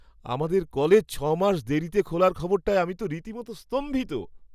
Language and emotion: Bengali, surprised